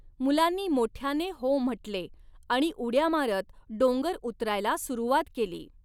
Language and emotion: Marathi, neutral